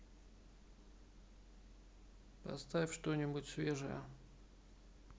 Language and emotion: Russian, neutral